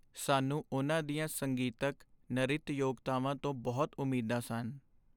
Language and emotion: Punjabi, sad